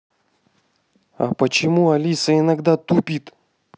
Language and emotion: Russian, angry